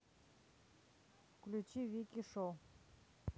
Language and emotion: Russian, neutral